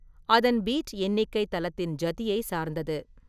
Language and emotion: Tamil, neutral